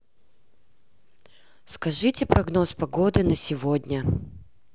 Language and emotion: Russian, neutral